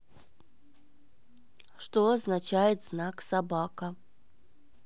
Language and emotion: Russian, neutral